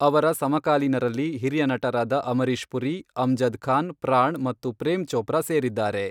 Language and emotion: Kannada, neutral